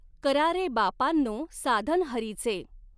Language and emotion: Marathi, neutral